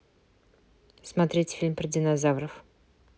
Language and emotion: Russian, neutral